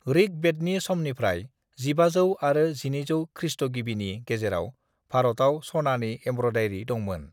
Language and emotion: Bodo, neutral